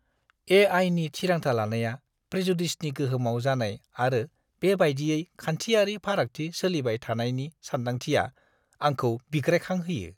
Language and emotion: Bodo, disgusted